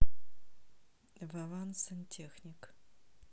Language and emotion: Russian, neutral